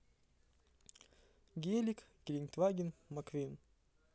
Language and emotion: Russian, neutral